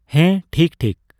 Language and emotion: Santali, neutral